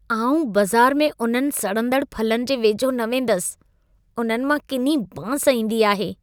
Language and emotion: Sindhi, disgusted